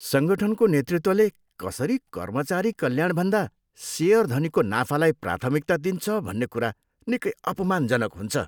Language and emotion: Nepali, disgusted